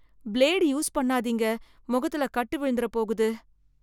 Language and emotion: Tamil, fearful